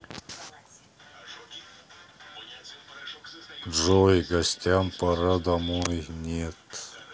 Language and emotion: Russian, neutral